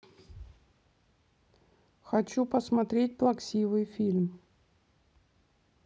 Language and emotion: Russian, neutral